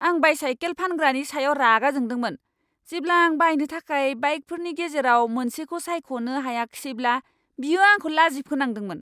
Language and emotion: Bodo, angry